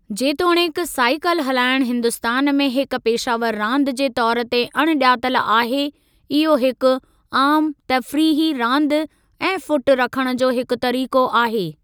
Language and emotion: Sindhi, neutral